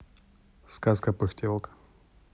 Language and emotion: Russian, neutral